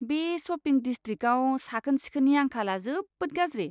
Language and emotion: Bodo, disgusted